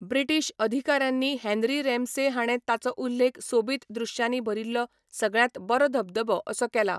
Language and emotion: Goan Konkani, neutral